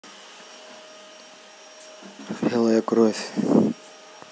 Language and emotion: Russian, neutral